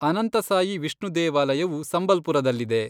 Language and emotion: Kannada, neutral